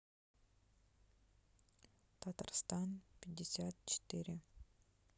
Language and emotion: Russian, sad